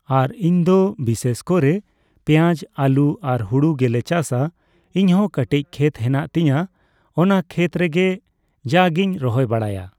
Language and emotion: Santali, neutral